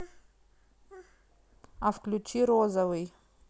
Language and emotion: Russian, neutral